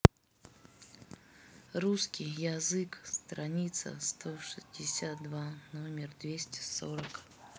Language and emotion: Russian, neutral